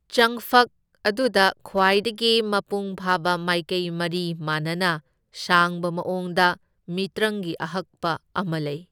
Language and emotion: Manipuri, neutral